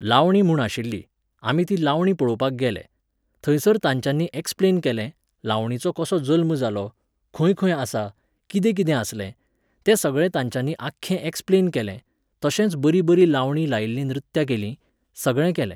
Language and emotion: Goan Konkani, neutral